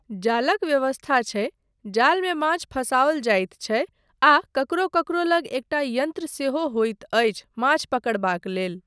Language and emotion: Maithili, neutral